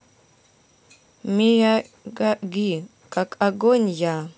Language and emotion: Russian, neutral